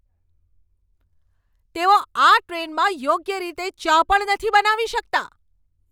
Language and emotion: Gujarati, angry